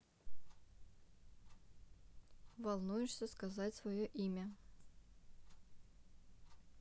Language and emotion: Russian, neutral